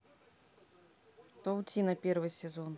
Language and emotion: Russian, neutral